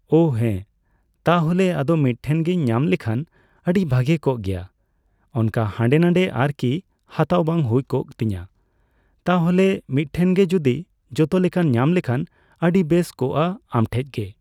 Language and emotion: Santali, neutral